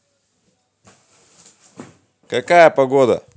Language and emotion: Russian, positive